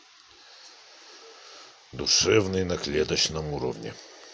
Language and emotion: Russian, neutral